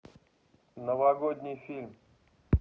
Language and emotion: Russian, neutral